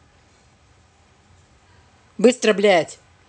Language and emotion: Russian, angry